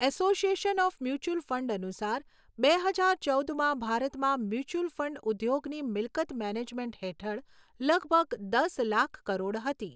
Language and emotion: Gujarati, neutral